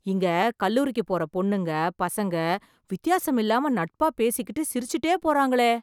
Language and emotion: Tamil, surprised